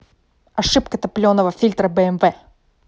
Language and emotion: Russian, angry